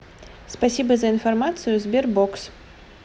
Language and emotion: Russian, positive